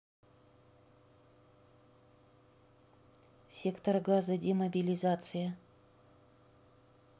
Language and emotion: Russian, neutral